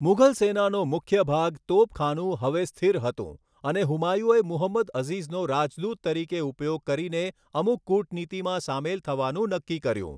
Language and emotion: Gujarati, neutral